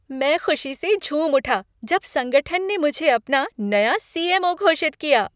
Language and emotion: Hindi, happy